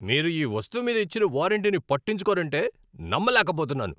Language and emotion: Telugu, angry